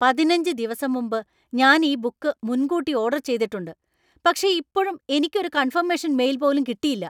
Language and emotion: Malayalam, angry